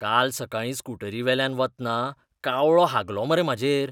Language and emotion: Goan Konkani, disgusted